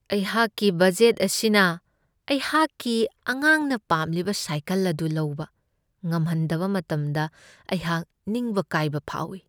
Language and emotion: Manipuri, sad